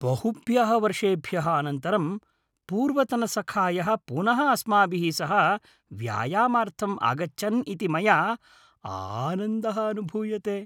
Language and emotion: Sanskrit, happy